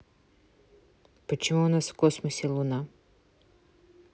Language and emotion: Russian, neutral